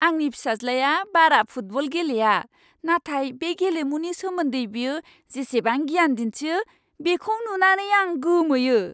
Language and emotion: Bodo, surprised